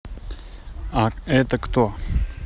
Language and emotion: Russian, neutral